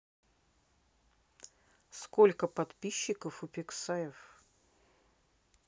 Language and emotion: Russian, neutral